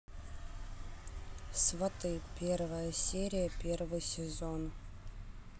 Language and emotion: Russian, neutral